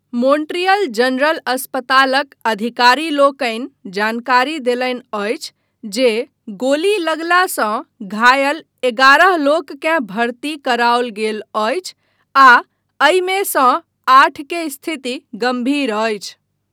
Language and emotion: Maithili, neutral